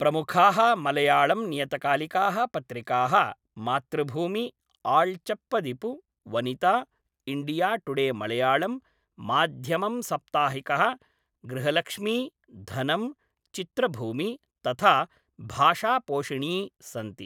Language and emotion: Sanskrit, neutral